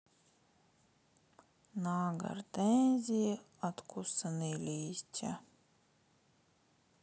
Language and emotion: Russian, sad